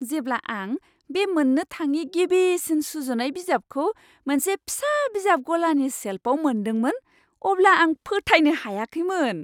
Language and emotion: Bodo, surprised